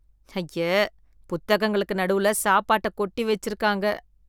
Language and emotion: Tamil, disgusted